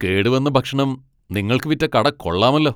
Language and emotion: Malayalam, angry